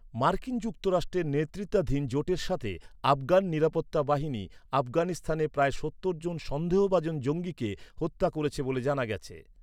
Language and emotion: Bengali, neutral